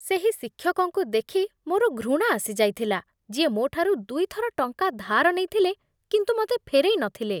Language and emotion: Odia, disgusted